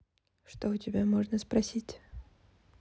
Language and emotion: Russian, neutral